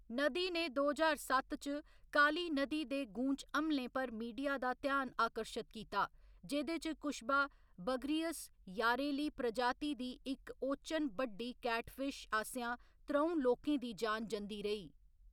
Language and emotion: Dogri, neutral